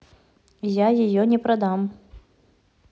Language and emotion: Russian, neutral